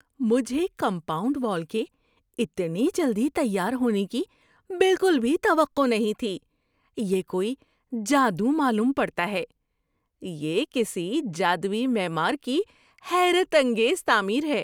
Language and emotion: Urdu, surprised